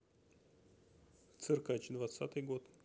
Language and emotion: Russian, neutral